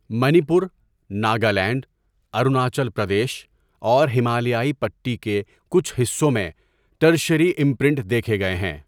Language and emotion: Urdu, neutral